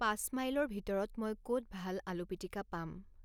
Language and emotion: Assamese, neutral